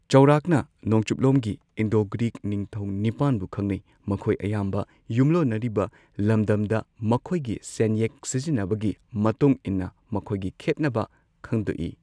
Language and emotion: Manipuri, neutral